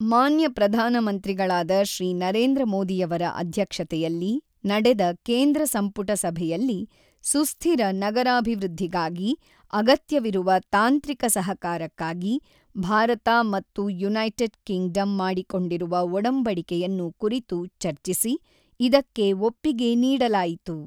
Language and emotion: Kannada, neutral